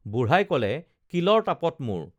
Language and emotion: Assamese, neutral